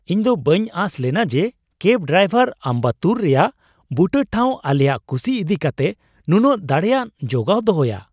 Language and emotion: Santali, surprised